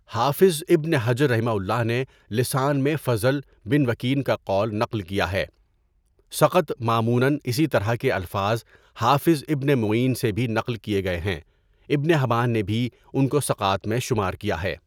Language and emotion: Urdu, neutral